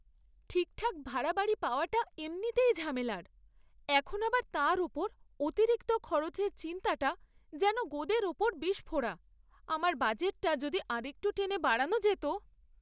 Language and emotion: Bengali, sad